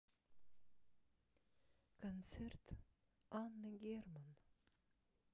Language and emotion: Russian, sad